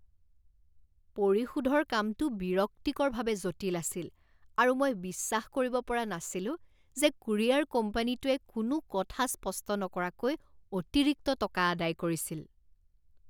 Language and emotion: Assamese, disgusted